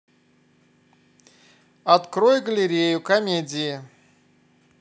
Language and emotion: Russian, neutral